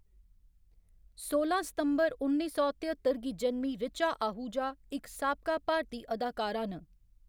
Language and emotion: Dogri, neutral